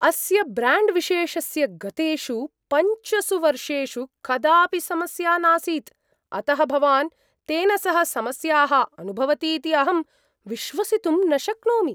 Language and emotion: Sanskrit, surprised